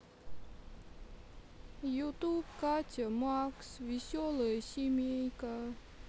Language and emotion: Russian, sad